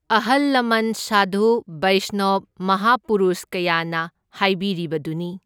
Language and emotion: Manipuri, neutral